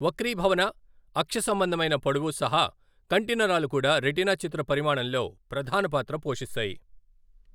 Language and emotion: Telugu, neutral